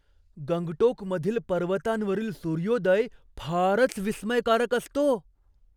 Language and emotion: Marathi, surprised